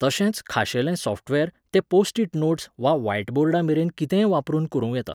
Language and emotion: Goan Konkani, neutral